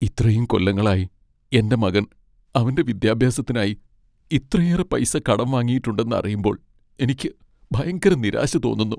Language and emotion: Malayalam, sad